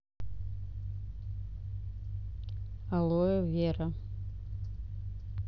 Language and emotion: Russian, neutral